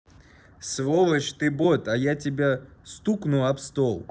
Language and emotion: Russian, angry